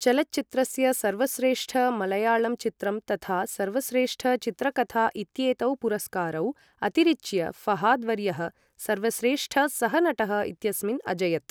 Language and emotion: Sanskrit, neutral